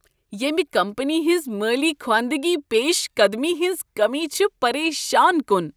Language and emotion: Kashmiri, disgusted